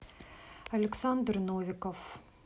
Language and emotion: Russian, neutral